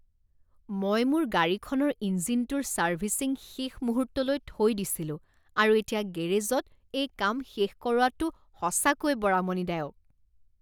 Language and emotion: Assamese, disgusted